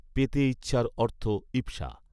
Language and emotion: Bengali, neutral